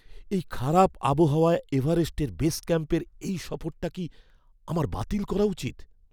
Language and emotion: Bengali, fearful